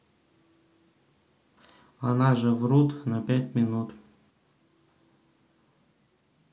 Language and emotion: Russian, neutral